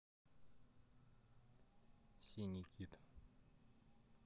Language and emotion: Russian, neutral